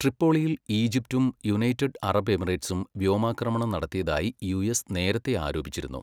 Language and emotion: Malayalam, neutral